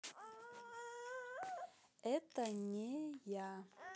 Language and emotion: Russian, neutral